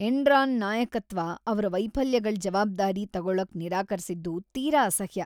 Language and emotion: Kannada, disgusted